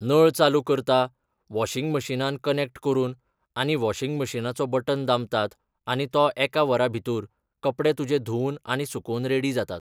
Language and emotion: Goan Konkani, neutral